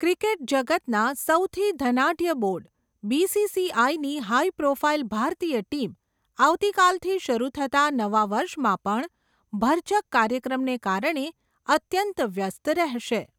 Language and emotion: Gujarati, neutral